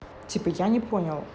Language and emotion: Russian, neutral